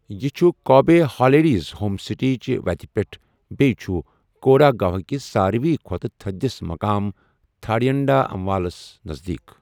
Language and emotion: Kashmiri, neutral